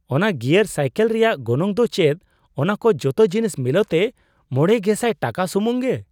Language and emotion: Santali, surprised